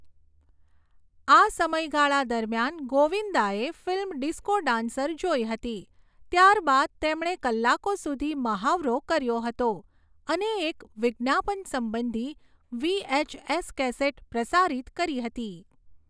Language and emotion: Gujarati, neutral